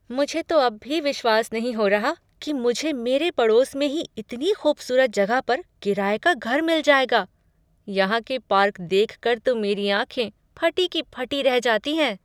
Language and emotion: Hindi, surprised